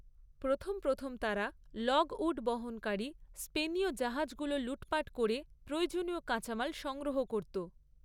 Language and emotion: Bengali, neutral